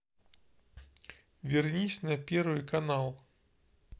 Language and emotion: Russian, neutral